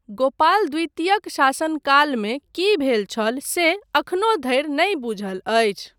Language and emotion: Maithili, neutral